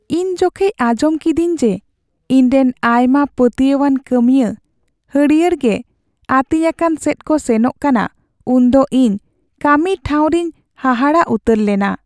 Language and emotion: Santali, sad